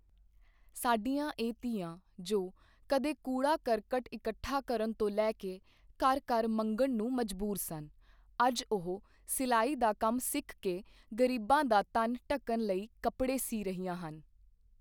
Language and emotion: Punjabi, neutral